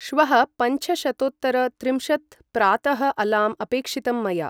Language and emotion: Sanskrit, neutral